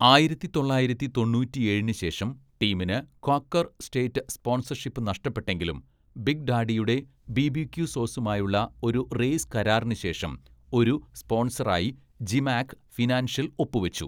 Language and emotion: Malayalam, neutral